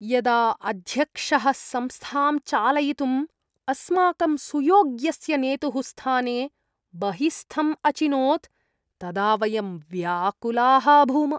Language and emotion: Sanskrit, disgusted